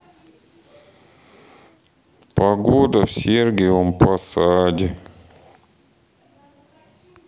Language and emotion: Russian, sad